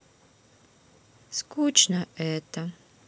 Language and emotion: Russian, sad